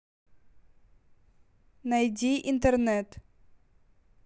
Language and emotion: Russian, neutral